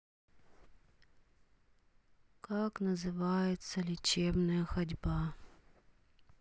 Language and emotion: Russian, sad